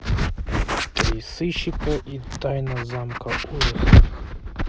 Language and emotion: Russian, neutral